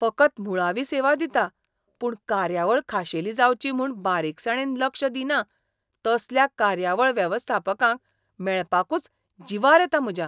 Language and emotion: Goan Konkani, disgusted